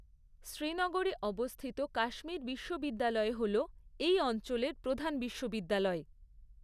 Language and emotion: Bengali, neutral